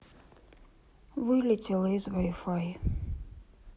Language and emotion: Russian, sad